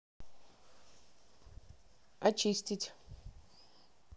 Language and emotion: Russian, neutral